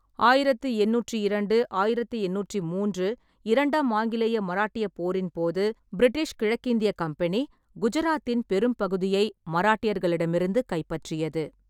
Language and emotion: Tamil, neutral